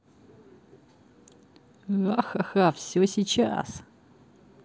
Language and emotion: Russian, positive